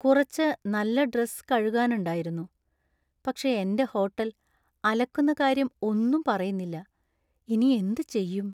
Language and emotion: Malayalam, sad